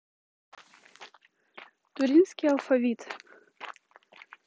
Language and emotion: Russian, neutral